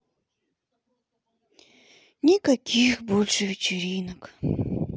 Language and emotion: Russian, sad